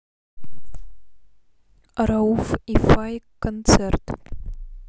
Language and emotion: Russian, neutral